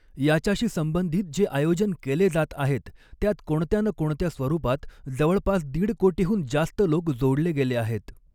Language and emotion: Marathi, neutral